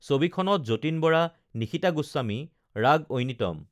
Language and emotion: Assamese, neutral